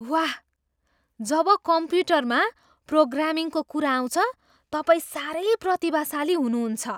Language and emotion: Nepali, surprised